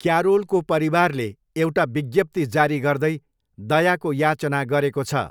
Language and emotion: Nepali, neutral